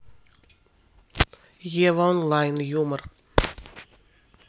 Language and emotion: Russian, neutral